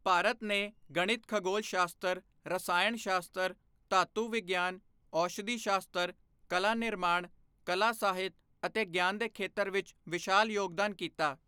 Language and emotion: Punjabi, neutral